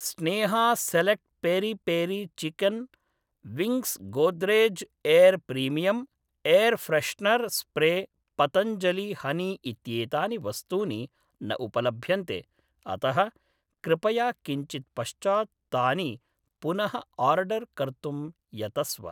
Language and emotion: Sanskrit, neutral